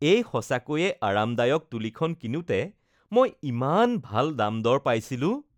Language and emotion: Assamese, happy